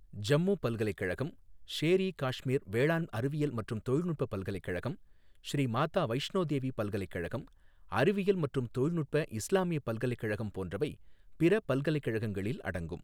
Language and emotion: Tamil, neutral